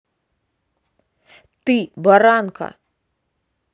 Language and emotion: Russian, angry